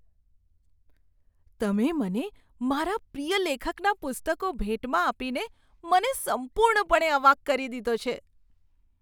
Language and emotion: Gujarati, surprised